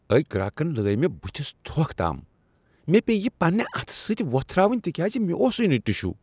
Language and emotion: Kashmiri, disgusted